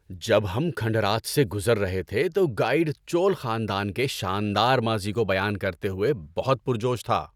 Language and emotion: Urdu, happy